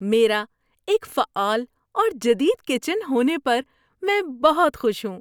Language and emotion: Urdu, happy